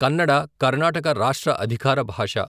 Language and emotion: Telugu, neutral